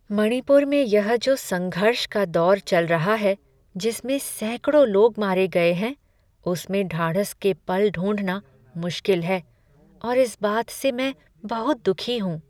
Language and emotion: Hindi, sad